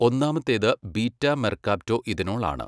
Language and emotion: Malayalam, neutral